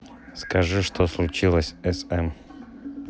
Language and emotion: Russian, neutral